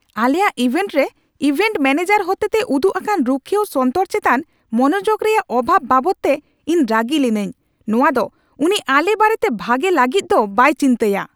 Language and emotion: Santali, angry